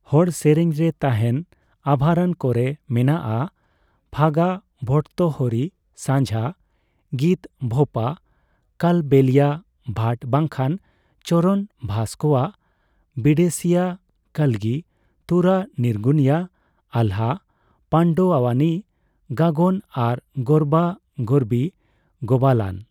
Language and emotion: Santali, neutral